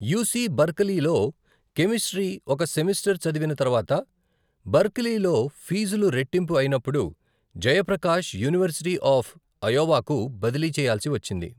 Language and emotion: Telugu, neutral